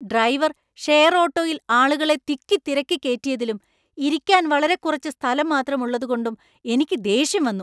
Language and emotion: Malayalam, angry